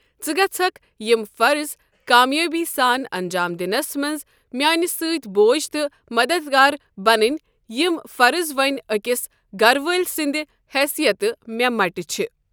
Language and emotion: Kashmiri, neutral